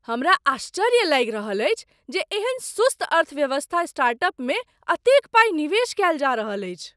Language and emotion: Maithili, surprised